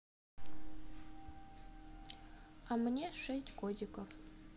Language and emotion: Russian, neutral